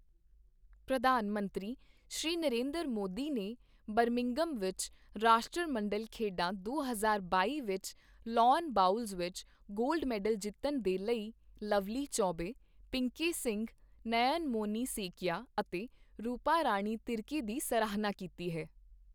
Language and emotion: Punjabi, neutral